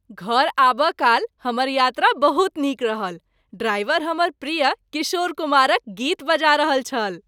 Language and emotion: Maithili, happy